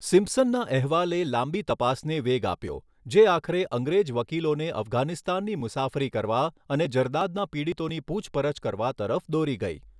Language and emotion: Gujarati, neutral